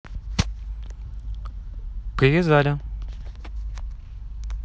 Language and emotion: Russian, neutral